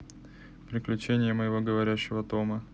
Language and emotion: Russian, neutral